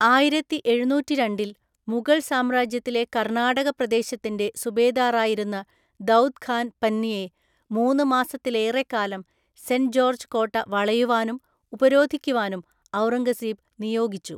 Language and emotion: Malayalam, neutral